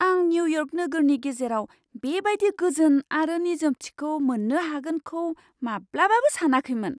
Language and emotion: Bodo, surprised